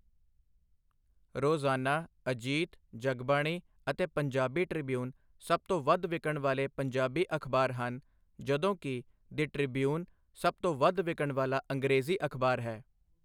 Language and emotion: Punjabi, neutral